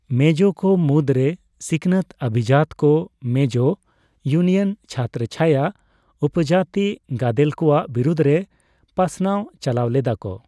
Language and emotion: Santali, neutral